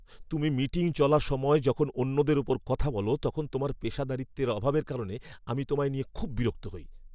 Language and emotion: Bengali, angry